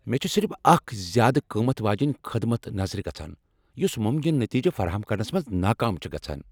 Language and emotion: Kashmiri, angry